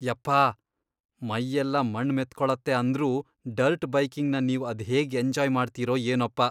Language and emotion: Kannada, disgusted